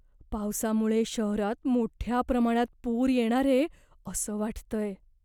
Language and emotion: Marathi, fearful